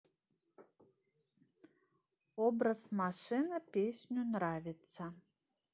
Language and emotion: Russian, neutral